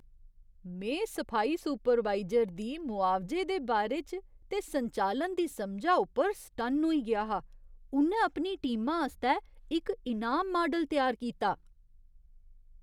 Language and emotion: Dogri, surprised